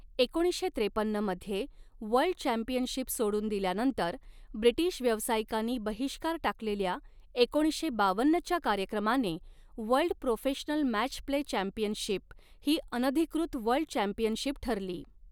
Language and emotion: Marathi, neutral